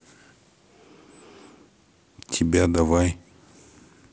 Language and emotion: Russian, neutral